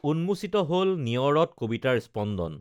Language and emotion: Assamese, neutral